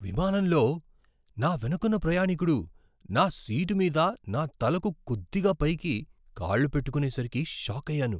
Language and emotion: Telugu, surprised